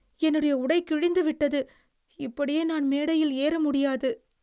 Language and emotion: Tamil, sad